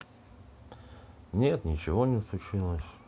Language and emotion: Russian, sad